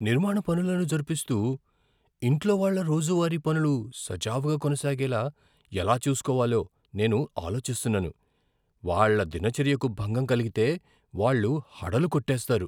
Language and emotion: Telugu, fearful